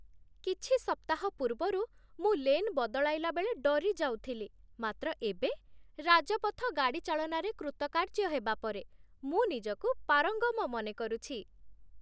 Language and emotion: Odia, happy